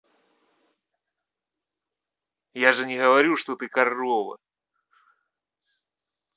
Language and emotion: Russian, angry